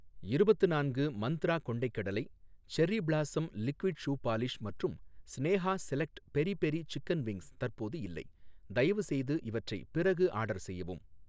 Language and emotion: Tamil, neutral